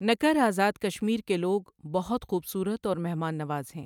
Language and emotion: Urdu, neutral